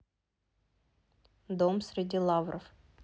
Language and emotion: Russian, neutral